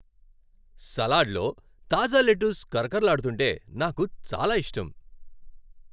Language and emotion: Telugu, happy